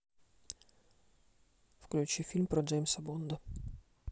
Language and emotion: Russian, neutral